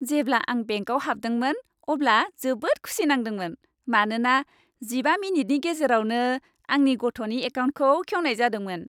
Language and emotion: Bodo, happy